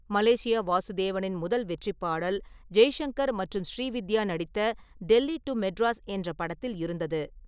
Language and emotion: Tamil, neutral